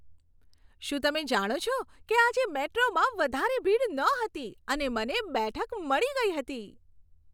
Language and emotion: Gujarati, happy